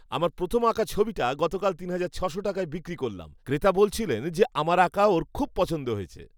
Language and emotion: Bengali, happy